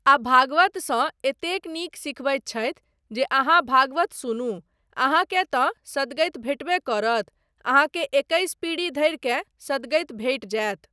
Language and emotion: Maithili, neutral